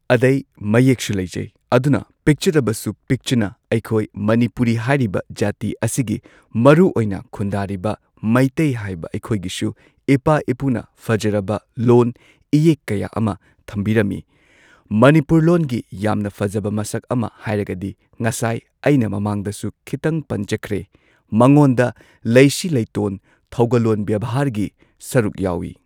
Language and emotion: Manipuri, neutral